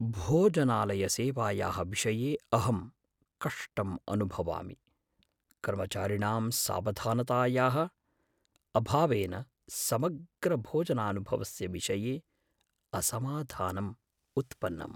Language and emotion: Sanskrit, fearful